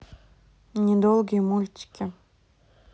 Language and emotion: Russian, neutral